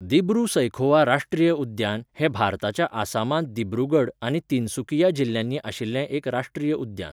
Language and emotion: Goan Konkani, neutral